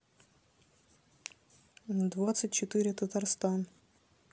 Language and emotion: Russian, neutral